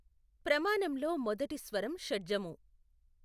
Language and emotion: Telugu, neutral